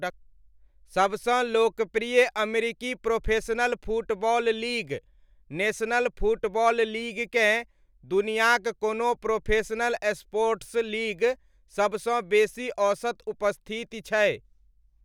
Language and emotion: Maithili, neutral